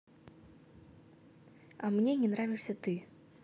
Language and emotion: Russian, neutral